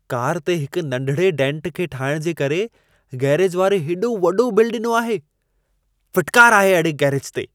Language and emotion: Sindhi, disgusted